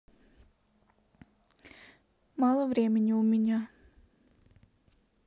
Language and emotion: Russian, neutral